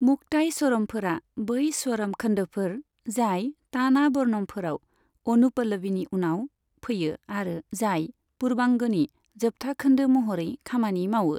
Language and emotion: Bodo, neutral